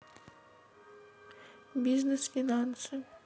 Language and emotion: Russian, neutral